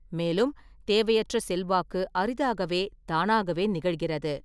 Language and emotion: Tamil, neutral